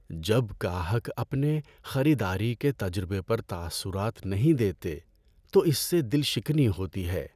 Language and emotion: Urdu, sad